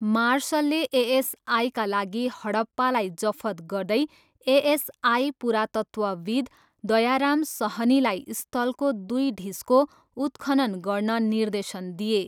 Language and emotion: Nepali, neutral